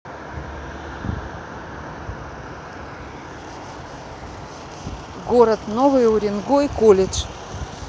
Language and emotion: Russian, neutral